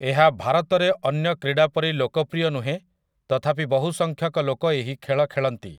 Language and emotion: Odia, neutral